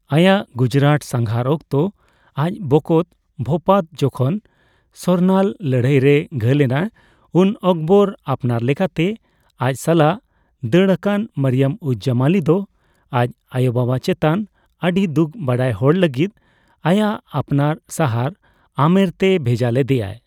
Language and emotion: Santali, neutral